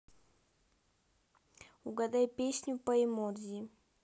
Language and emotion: Russian, neutral